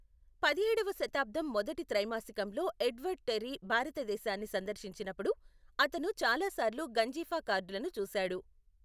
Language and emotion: Telugu, neutral